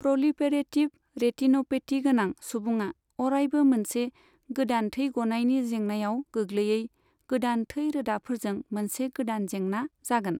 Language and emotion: Bodo, neutral